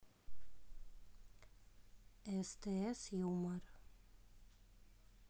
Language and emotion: Russian, neutral